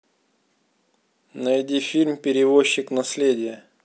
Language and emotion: Russian, neutral